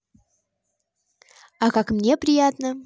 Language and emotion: Russian, positive